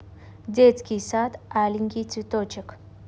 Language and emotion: Russian, neutral